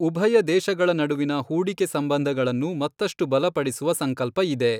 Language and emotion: Kannada, neutral